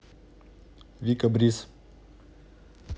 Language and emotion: Russian, neutral